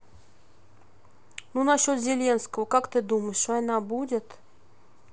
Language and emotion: Russian, neutral